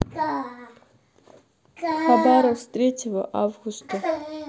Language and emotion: Russian, neutral